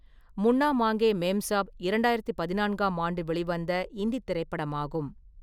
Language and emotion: Tamil, neutral